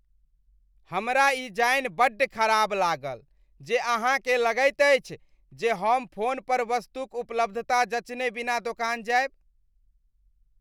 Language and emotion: Maithili, disgusted